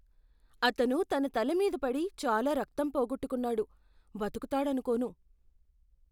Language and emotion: Telugu, fearful